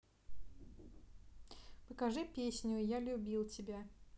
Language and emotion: Russian, neutral